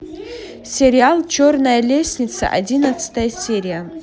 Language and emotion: Russian, neutral